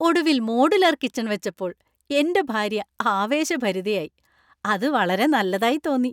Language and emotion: Malayalam, happy